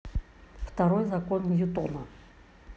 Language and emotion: Russian, neutral